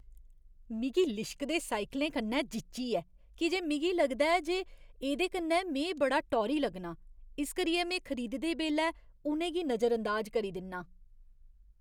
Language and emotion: Dogri, disgusted